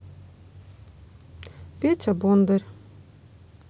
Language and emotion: Russian, neutral